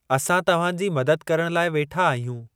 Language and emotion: Sindhi, neutral